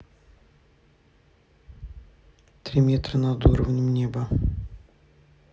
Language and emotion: Russian, neutral